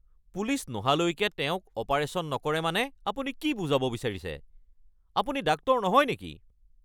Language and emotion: Assamese, angry